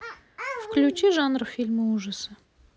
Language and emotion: Russian, neutral